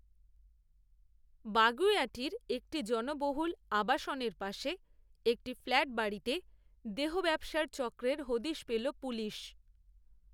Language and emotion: Bengali, neutral